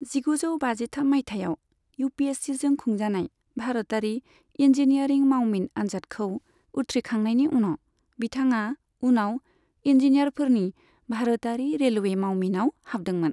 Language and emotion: Bodo, neutral